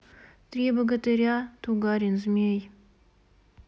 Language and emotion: Russian, neutral